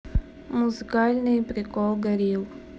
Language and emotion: Russian, neutral